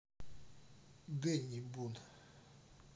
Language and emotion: Russian, neutral